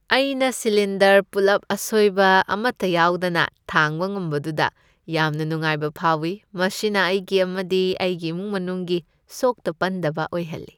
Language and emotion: Manipuri, happy